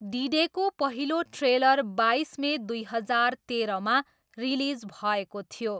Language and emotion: Nepali, neutral